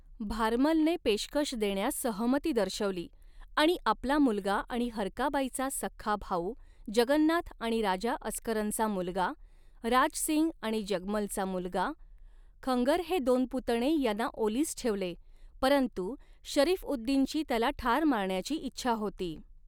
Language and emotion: Marathi, neutral